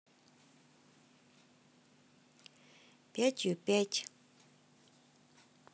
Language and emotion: Russian, neutral